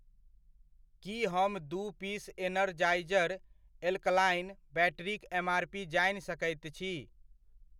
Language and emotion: Maithili, neutral